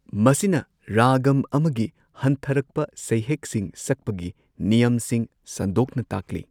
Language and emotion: Manipuri, neutral